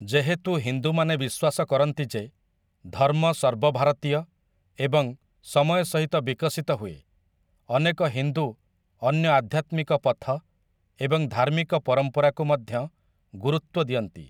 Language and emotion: Odia, neutral